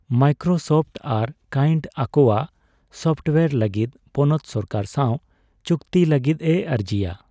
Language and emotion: Santali, neutral